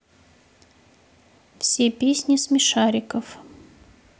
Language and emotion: Russian, neutral